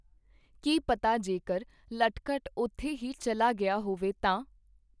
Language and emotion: Punjabi, neutral